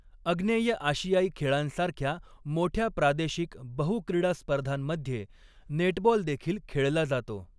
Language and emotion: Marathi, neutral